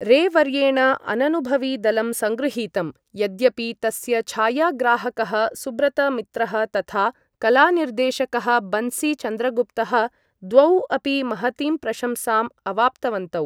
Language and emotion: Sanskrit, neutral